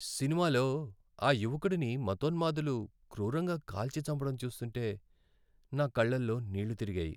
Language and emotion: Telugu, sad